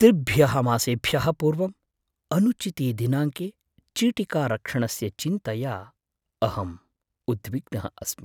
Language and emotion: Sanskrit, fearful